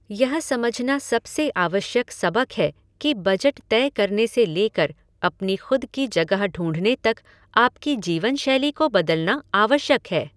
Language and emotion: Hindi, neutral